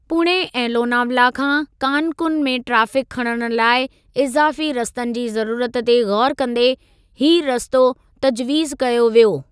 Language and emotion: Sindhi, neutral